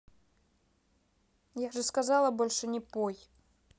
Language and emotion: Russian, angry